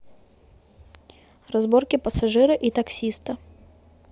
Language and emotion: Russian, neutral